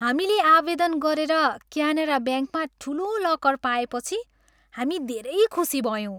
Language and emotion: Nepali, happy